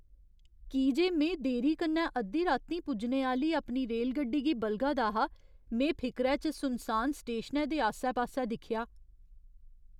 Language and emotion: Dogri, fearful